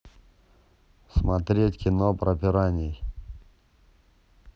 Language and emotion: Russian, neutral